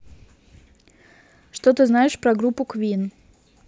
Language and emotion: Russian, neutral